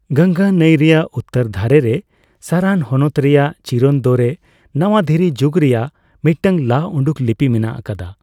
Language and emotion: Santali, neutral